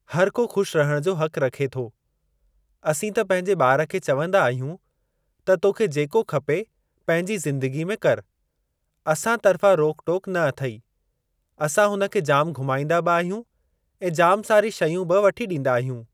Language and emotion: Sindhi, neutral